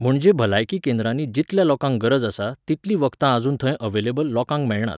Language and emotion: Goan Konkani, neutral